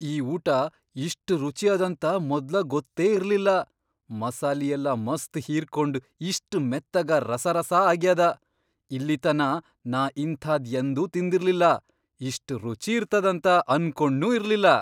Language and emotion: Kannada, surprised